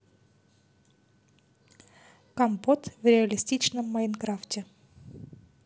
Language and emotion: Russian, neutral